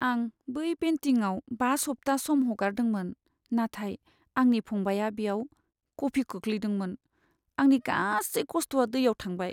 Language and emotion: Bodo, sad